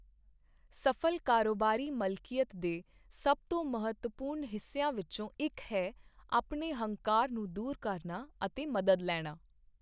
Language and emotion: Punjabi, neutral